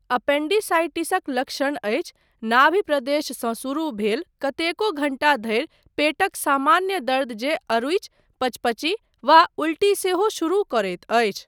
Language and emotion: Maithili, neutral